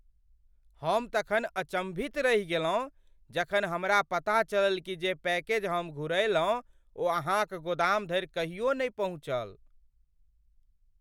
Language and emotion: Maithili, surprised